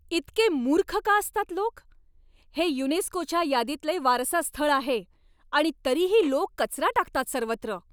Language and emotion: Marathi, angry